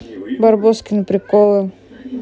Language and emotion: Russian, neutral